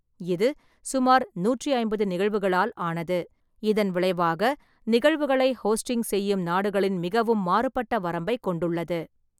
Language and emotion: Tamil, neutral